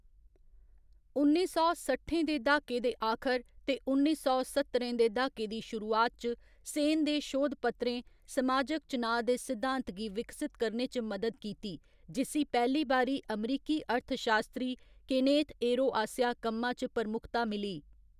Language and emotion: Dogri, neutral